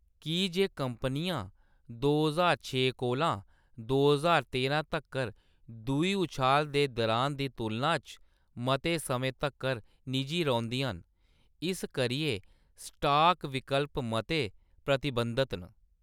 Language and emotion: Dogri, neutral